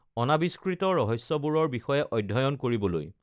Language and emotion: Assamese, neutral